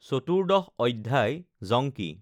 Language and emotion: Assamese, neutral